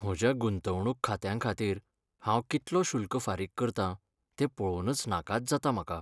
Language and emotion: Goan Konkani, sad